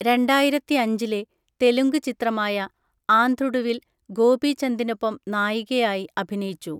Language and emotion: Malayalam, neutral